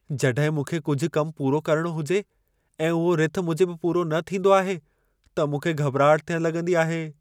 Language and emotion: Sindhi, fearful